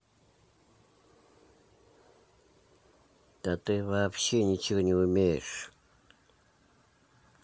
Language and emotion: Russian, angry